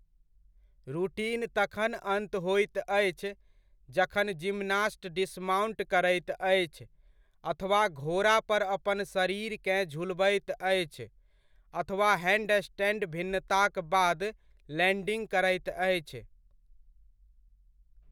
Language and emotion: Maithili, neutral